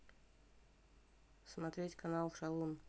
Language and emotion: Russian, neutral